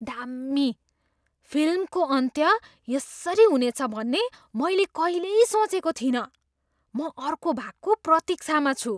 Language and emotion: Nepali, surprised